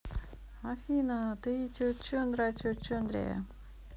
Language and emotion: Russian, positive